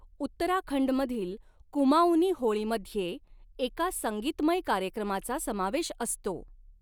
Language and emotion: Marathi, neutral